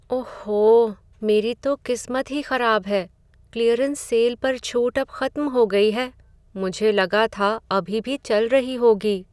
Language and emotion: Hindi, sad